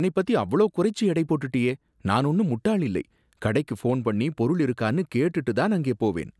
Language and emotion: Tamil, disgusted